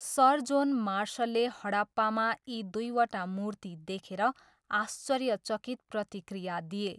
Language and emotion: Nepali, neutral